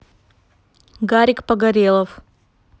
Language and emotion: Russian, neutral